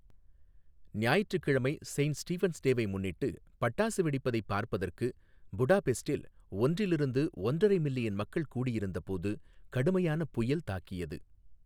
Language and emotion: Tamil, neutral